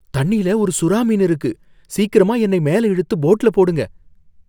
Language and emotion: Tamil, fearful